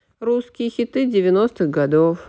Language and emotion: Russian, neutral